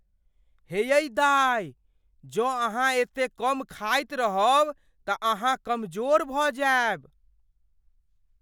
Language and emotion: Maithili, fearful